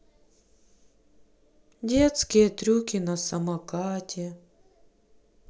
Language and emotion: Russian, sad